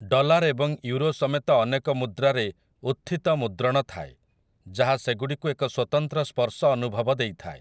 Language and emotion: Odia, neutral